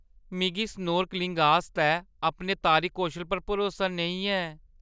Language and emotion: Dogri, fearful